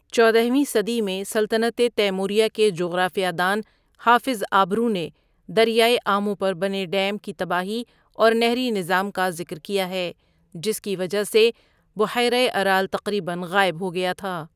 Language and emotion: Urdu, neutral